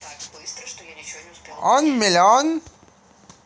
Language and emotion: Russian, positive